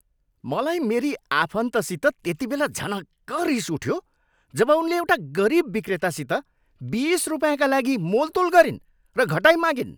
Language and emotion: Nepali, angry